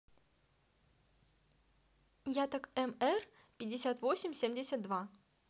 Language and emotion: Russian, neutral